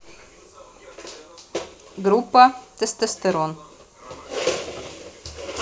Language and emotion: Russian, neutral